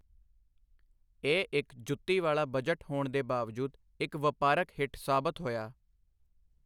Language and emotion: Punjabi, neutral